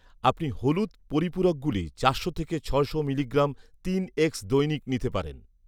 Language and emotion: Bengali, neutral